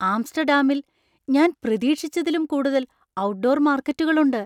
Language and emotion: Malayalam, surprised